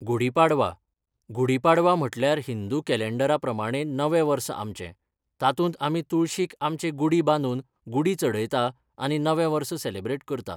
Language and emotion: Goan Konkani, neutral